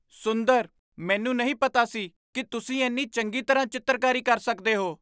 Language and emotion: Punjabi, surprised